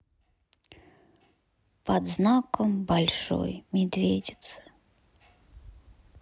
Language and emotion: Russian, sad